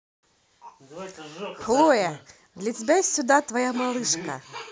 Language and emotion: Russian, positive